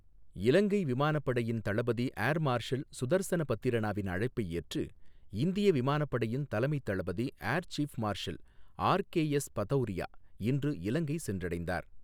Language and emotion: Tamil, neutral